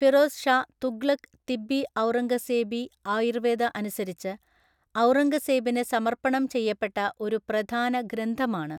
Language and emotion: Malayalam, neutral